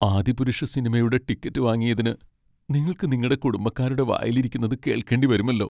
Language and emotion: Malayalam, sad